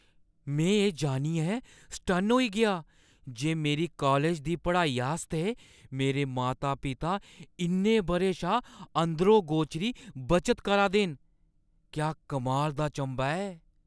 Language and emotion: Dogri, surprised